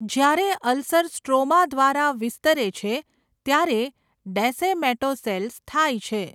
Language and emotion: Gujarati, neutral